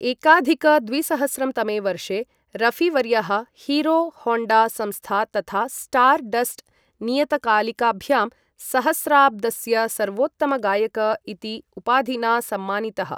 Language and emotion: Sanskrit, neutral